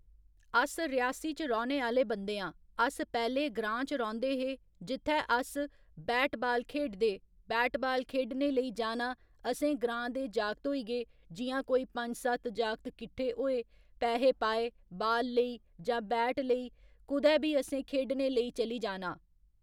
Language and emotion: Dogri, neutral